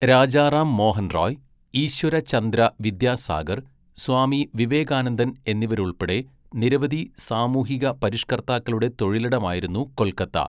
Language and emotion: Malayalam, neutral